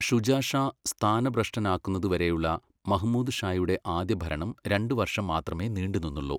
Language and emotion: Malayalam, neutral